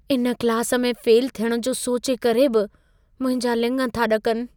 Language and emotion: Sindhi, fearful